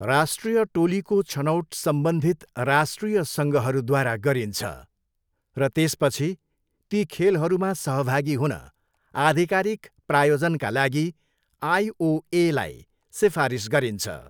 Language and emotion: Nepali, neutral